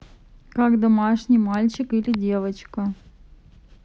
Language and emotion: Russian, neutral